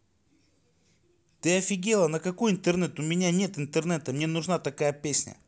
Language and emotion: Russian, neutral